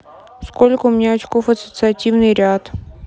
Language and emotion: Russian, neutral